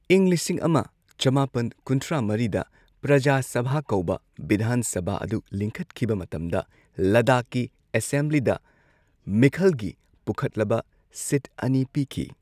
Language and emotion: Manipuri, neutral